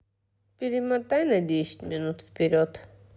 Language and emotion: Russian, neutral